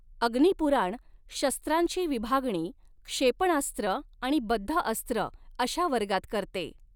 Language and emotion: Marathi, neutral